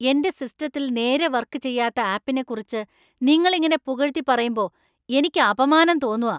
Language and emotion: Malayalam, angry